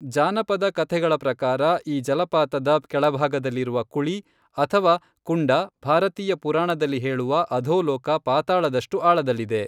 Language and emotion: Kannada, neutral